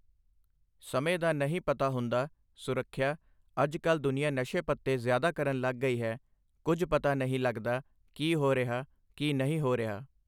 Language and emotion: Punjabi, neutral